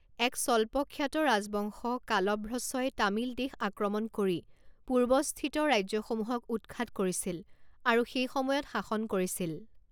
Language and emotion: Assamese, neutral